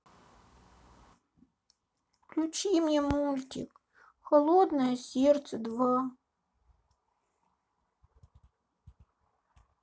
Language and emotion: Russian, sad